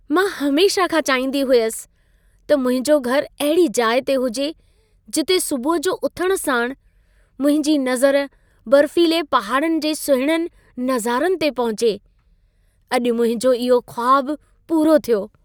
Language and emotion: Sindhi, happy